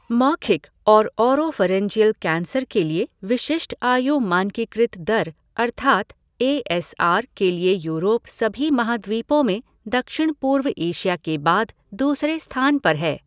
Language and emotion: Hindi, neutral